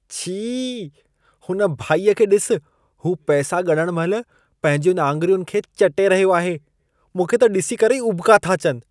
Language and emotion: Sindhi, disgusted